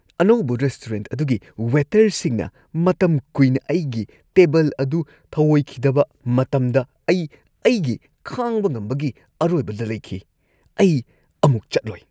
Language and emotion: Manipuri, disgusted